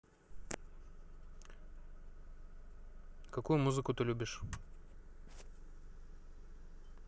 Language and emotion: Russian, neutral